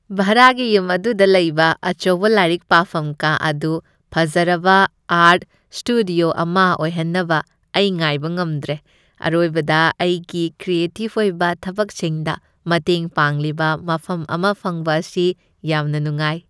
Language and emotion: Manipuri, happy